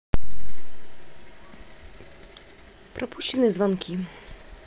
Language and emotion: Russian, neutral